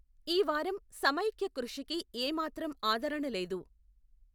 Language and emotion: Telugu, neutral